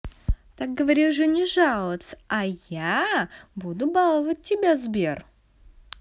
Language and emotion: Russian, positive